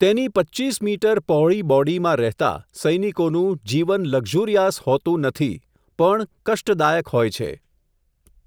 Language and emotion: Gujarati, neutral